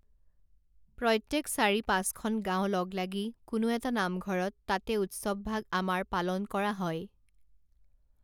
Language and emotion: Assamese, neutral